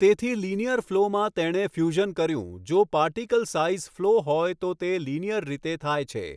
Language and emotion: Gujarati, neutral